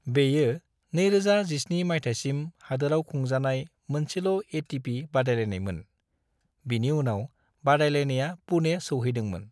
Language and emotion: Bodo, neutral